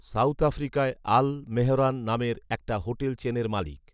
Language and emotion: Bengali, neutral